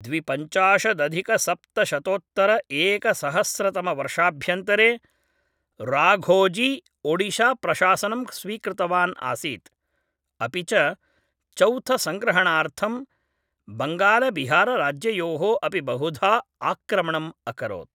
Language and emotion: Sanskrit, neutral